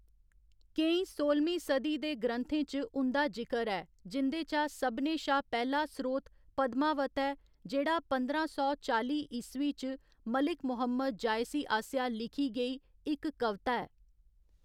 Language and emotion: Dogri, neutral